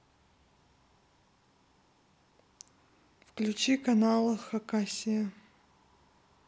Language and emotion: Russian, neutral